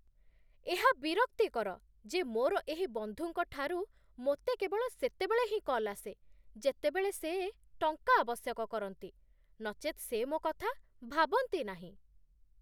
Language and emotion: Odia, disgusted